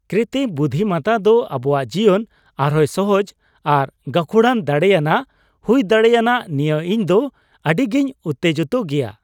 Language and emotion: Santali, happy